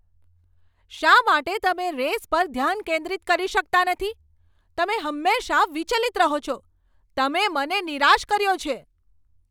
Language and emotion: Gujarati, angry